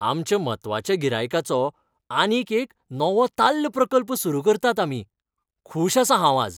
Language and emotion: Goan Konkani, happy